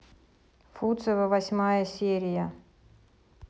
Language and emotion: Russian, neutral